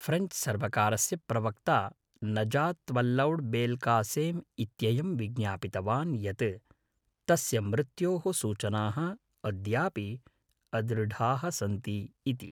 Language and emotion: Sanskrit, neutral